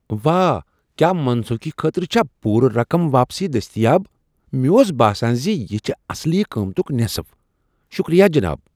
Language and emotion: Kashmiri, surprised